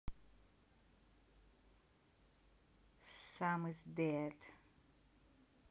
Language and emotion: Russian, neutral